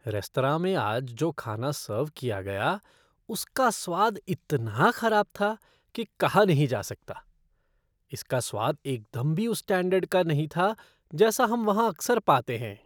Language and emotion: Hindi, disgusted